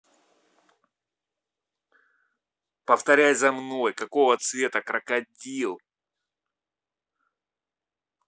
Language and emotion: Russian, angry